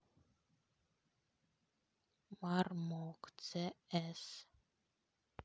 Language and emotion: Russian, neutral